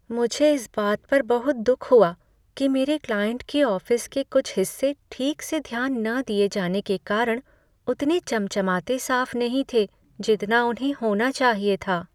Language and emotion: Hindi, sad